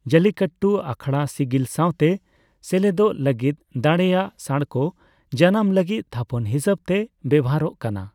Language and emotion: Santali, neutral